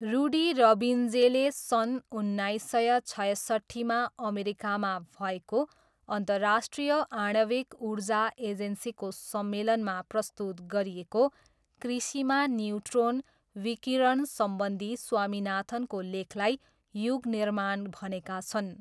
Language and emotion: Nepali, neutral